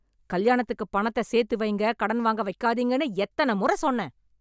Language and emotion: Tamil, angry